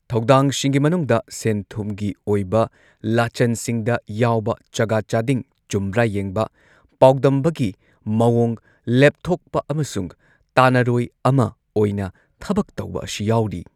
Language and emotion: Manipuri, neutral